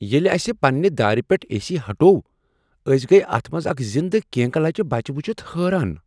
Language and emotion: Kashmiri, surprised